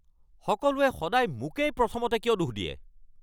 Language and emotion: Assamese, angry